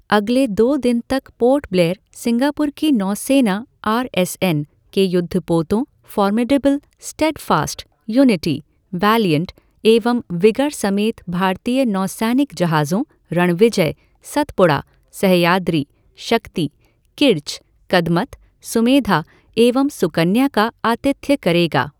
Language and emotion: Hindi, neutral